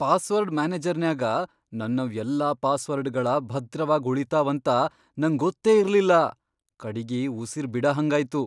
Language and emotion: Kannada, surprised